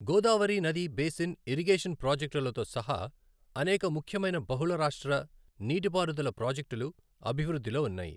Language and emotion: Telugu, neutral